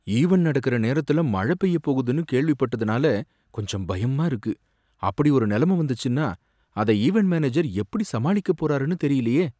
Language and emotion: Tamil, fearful